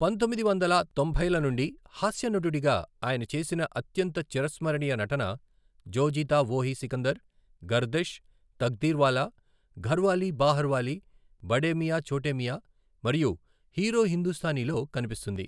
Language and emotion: Telugu, neutral